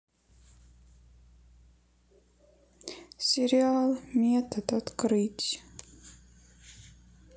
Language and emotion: Russian, sad